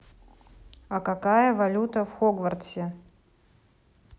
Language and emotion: Russian, neutral